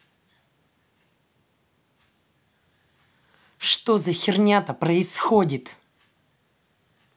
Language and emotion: Russian, angry